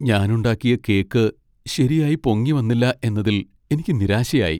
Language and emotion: Malayalam, sad